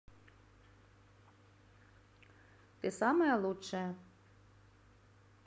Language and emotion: Russian, positive